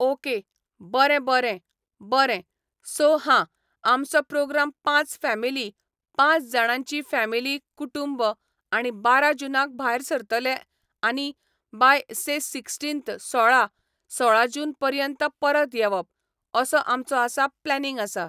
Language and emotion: Goan Konkani, neutral